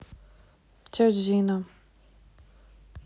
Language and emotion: Russian, neutral